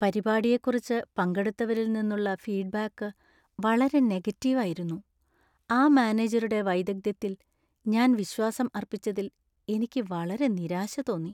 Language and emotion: Malayalam, sad